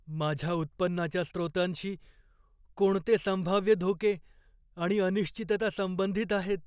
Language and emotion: Marathi, fearful